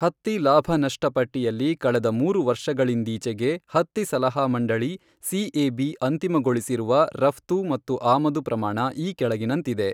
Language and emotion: Kannada, neutral